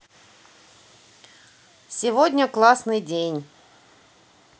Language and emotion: Russian, positive